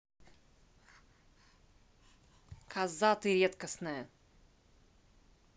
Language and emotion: Russian, angry